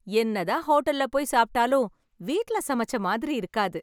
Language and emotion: Tamil, happy